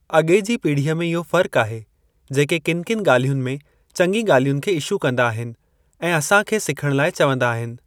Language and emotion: Sindhi, neutral